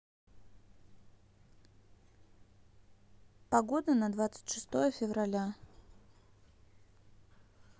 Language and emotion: Russian, neutral